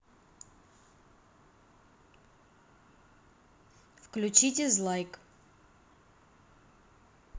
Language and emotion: Russian, neutral